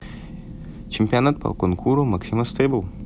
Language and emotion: Russian, neutral